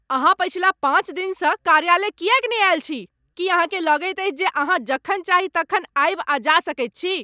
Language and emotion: Maithili, angry